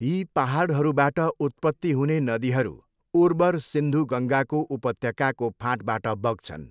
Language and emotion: Nepali, neutral